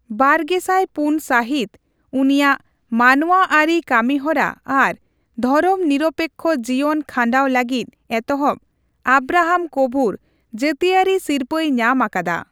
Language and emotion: Santali, neutral